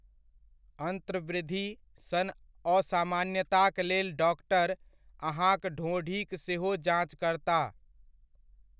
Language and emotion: Maithili, neutral